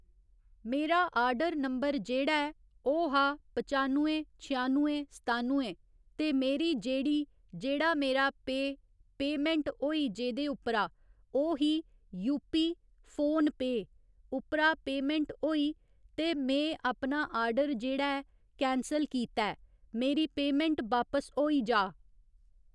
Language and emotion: Dogri, neutral